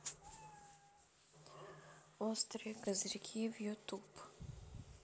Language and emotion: Russian, neutral